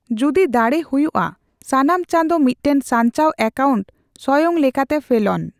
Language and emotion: Santali, neutral